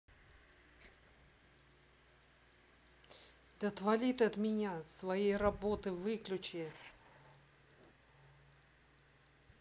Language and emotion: Russian, angry